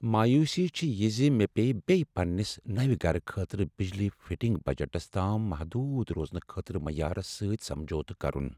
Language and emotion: Kashmiri, sad